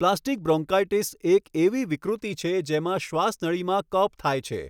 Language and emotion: Gujarati, neutral